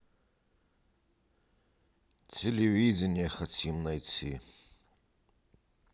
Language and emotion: Russian, neutral